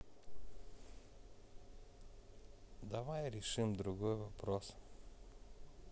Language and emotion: Russian, sad